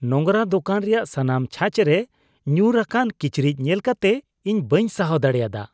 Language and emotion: Santali, disgusted